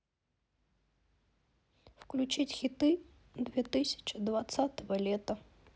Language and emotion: Russian, sad